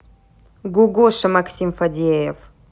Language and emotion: Russian, neutral